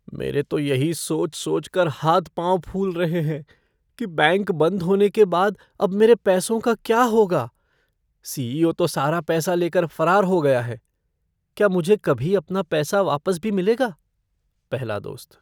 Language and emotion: Hindi, fearful